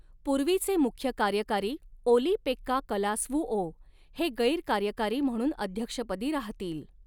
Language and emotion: Marathi, neutral